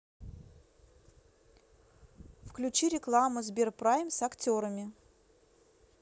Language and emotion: Russian, neutral